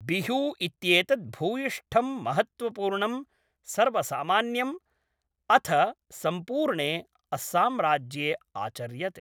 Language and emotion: Sanskrit, neutral